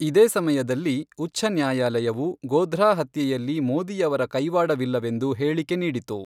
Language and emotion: Kannada, neutral